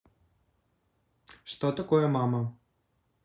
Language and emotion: Russian, neutral